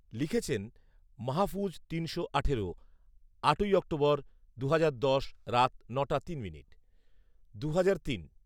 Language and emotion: Bengali, neutral